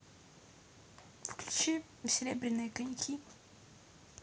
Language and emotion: Russian, neutral